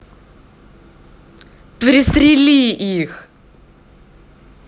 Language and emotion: Russian, angry